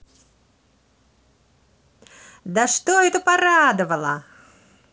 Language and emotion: Russian, positive